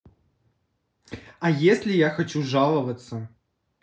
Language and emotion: Russian, neutral